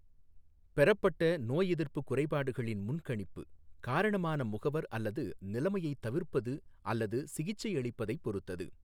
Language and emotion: Tamil, neutral